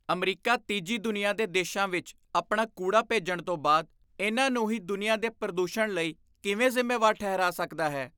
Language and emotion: Punjabi, disgusted